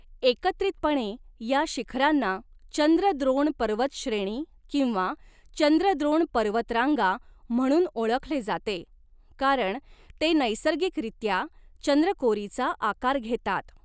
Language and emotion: Marathi, neutral